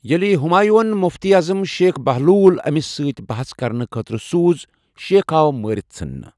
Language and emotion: Kashmiri, neutral